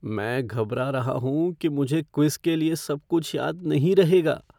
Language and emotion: Hindi, fearful